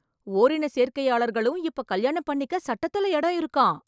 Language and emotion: Tamil, surprised